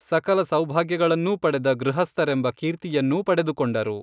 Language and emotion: Kannada, neutral